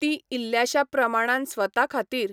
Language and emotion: Goan Konkani, neutral